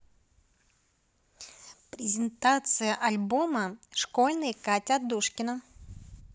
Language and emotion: Russian, neutral